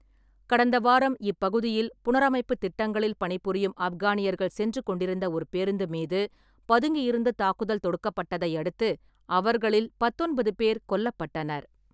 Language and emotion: Tamil, neutral